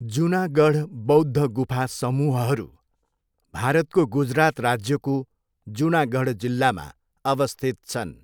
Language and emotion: Nepali, neutral